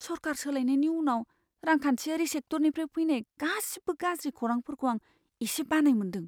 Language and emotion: Bodo, fearful